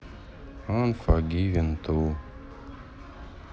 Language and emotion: Russian, sad